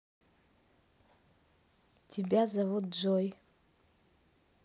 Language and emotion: Russian, neutral